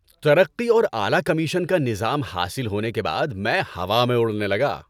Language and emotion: Urdu, happy